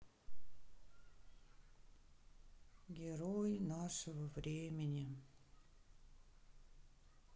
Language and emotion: Russian, sad